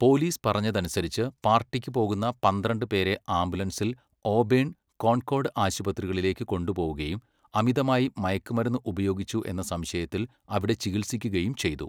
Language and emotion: Malayalam, neutral